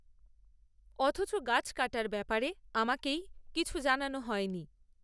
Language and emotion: Bengali, neutral